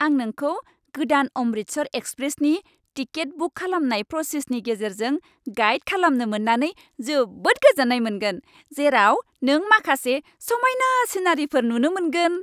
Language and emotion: Bodo, happy